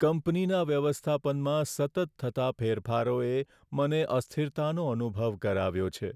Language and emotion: Gujarati, sad